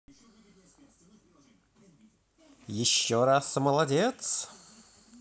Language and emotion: Russian, positive